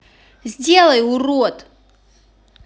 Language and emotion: Russian, angry